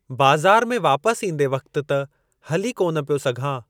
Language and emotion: Sindhi, neutral